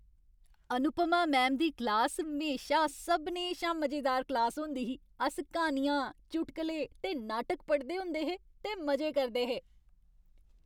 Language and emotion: Dogri, happy